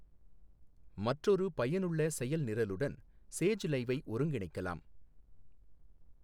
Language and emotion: Tamil, neutral